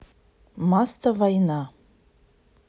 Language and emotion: Russian, neutral